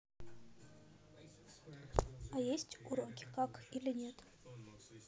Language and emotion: Russian, neutral